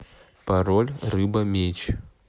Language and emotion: Russian, neutral